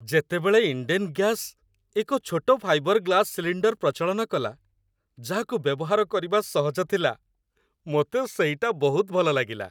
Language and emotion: Odia, happy